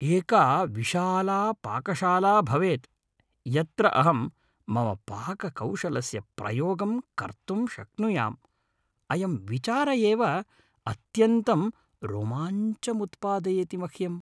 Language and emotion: Sanskrit, happy